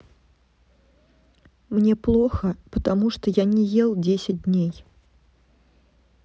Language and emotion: Russian, sad